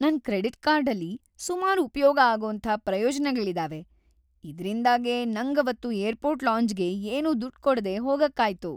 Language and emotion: Kannada, happy